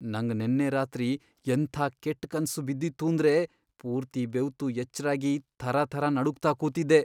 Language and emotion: Kannada, fearful